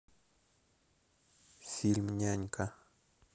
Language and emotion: Russian, neutral